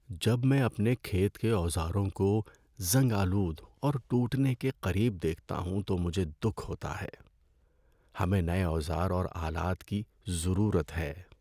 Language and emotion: Urdu, sad